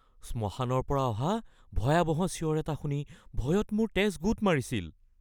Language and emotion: Assamese, fearful